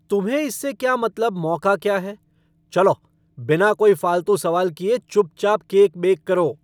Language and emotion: Hindi, angry